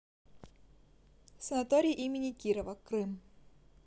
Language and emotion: Russian, neutral